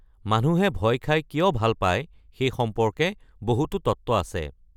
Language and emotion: Assamese, neutral